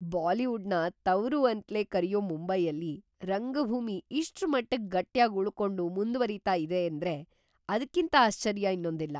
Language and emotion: Kannada, surprised